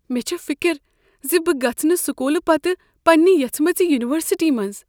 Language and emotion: Kashmiri, fearful